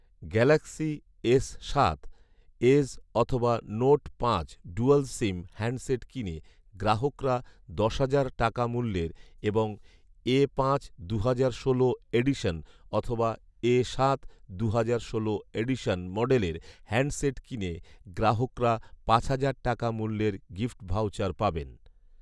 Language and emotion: Bengali, neutral